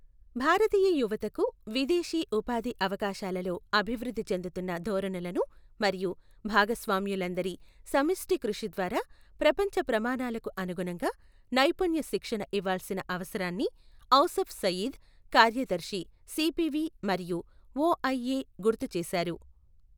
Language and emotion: Telugu, neutral